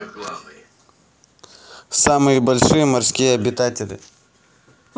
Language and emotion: Russian, positive